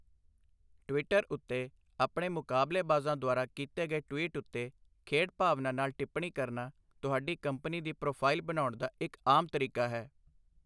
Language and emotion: Punjabi, neutral